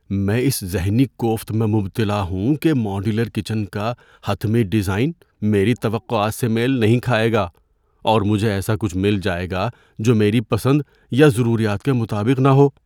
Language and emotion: Urdu, fearful